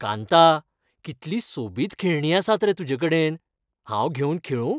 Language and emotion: Goan Konkani, happy